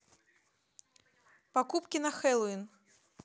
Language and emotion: Russian, neutral